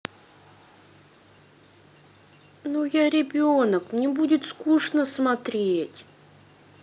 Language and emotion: Russian, sad